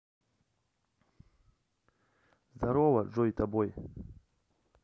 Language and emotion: Russian, neutral